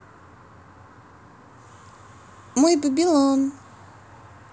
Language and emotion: Russian, positive